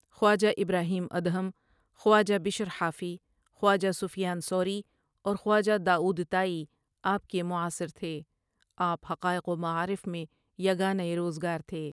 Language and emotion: Urdu, neutral